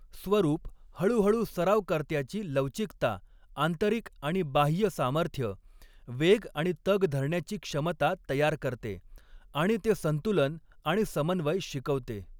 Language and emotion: Marathi, neutral